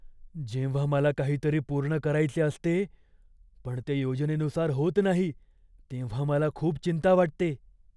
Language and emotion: Marathi, fearful